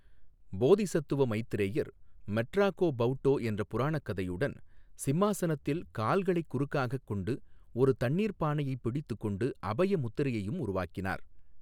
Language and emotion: Tamil, neutral